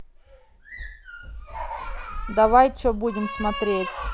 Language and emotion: Russian, angry